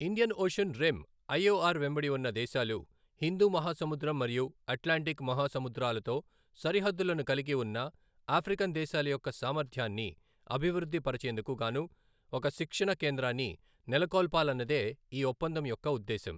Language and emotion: Telugu, neutral